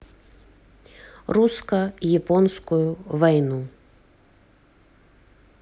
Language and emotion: Russian, neutral